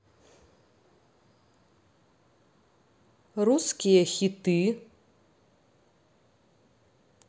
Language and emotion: Russian, neutral